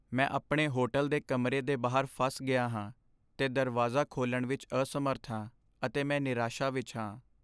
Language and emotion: Punjabi, sad